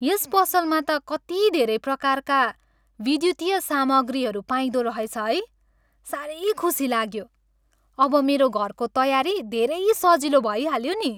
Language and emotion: Nepali, happy